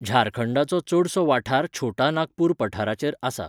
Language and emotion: Goan Konkani, neutral